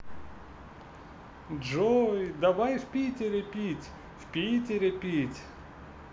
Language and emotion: Russian, positive